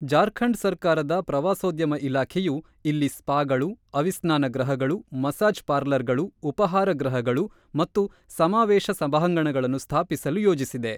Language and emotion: Kannada, neutral